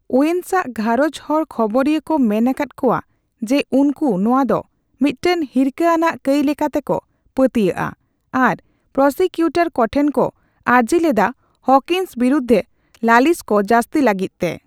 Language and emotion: Santali, neutral